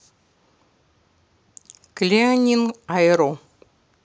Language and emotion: Russian, neutral